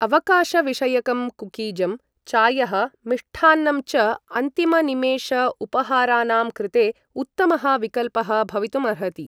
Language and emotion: Sanskrit, neutral